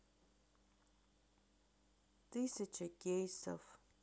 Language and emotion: Russian, neutral